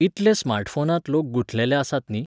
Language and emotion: Goan Konkani, neutral